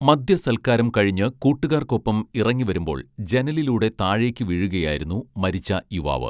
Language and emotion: Malayalam, neutral